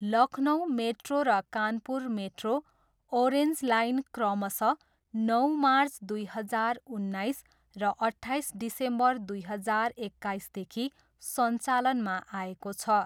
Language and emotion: Nepali, neutral